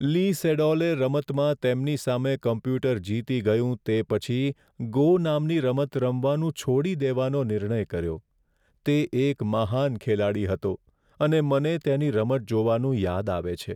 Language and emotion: Gujarati, sad